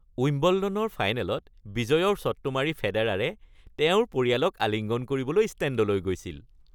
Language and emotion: Assamese, happy